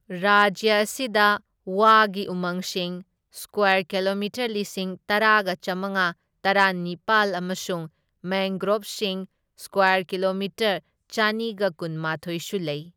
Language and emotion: Manipuri, neutral